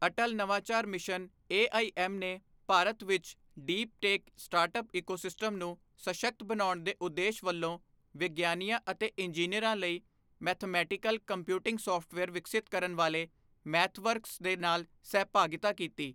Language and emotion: Punjabi, neutral